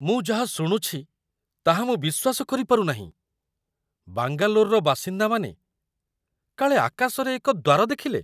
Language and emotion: Odia, surprised